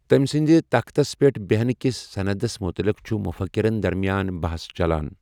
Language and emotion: Kashmiri, neutral